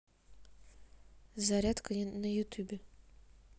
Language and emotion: Russian, neutral